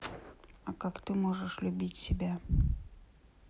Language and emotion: Russian, neutral